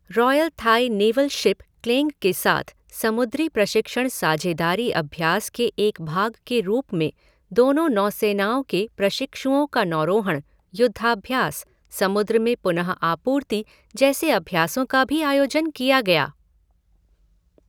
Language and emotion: Hindi, neutral